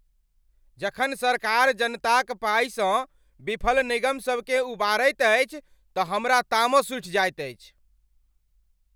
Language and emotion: Maithili, angry